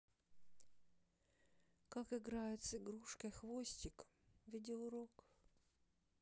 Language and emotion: Russian, sad